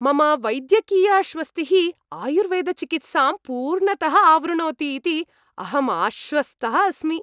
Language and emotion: Sanskrit, happy